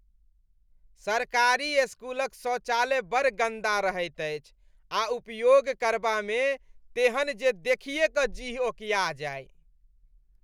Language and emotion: Maithili, disgusted